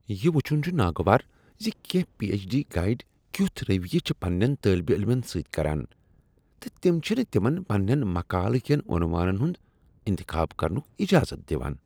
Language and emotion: Kashmiri, disgusted